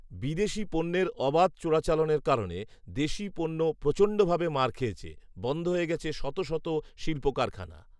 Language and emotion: Bengali, neutral